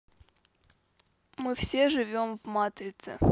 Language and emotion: Russian, neutral